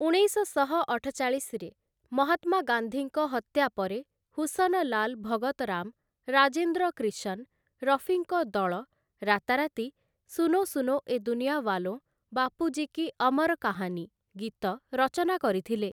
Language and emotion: Odia, neutral